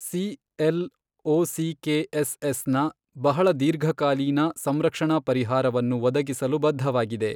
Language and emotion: Kannada, neutral